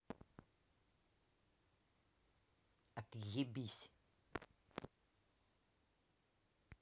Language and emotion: Russian, angry